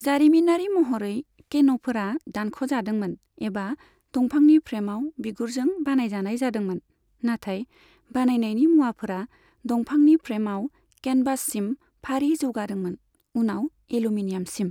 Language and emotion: Bodo, neutral